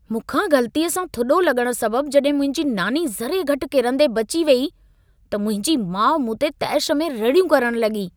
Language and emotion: Sindhi, angry